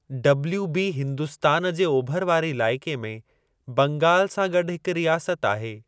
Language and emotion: Sindhi, neutral